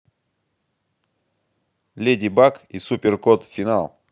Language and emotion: Russian, positive